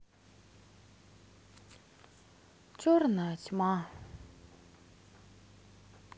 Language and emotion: Russian, sad